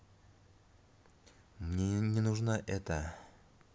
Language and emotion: Russian, neutral